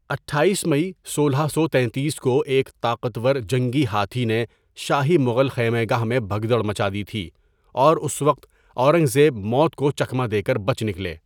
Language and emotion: Urdu, neutral